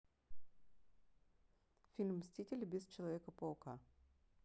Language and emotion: Russian, neutral